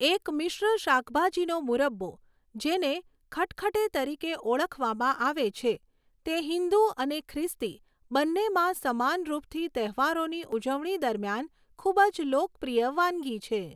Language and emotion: Gujarati, neutral